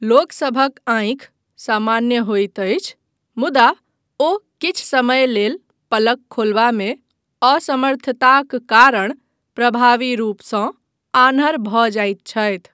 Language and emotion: Maithili, neutral